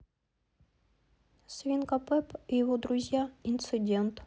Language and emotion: Russian, neutral